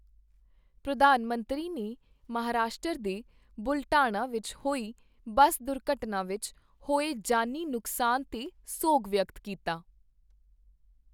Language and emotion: Punjabi, neutral